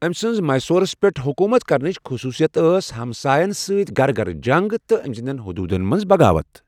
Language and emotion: Kashmiri, neutral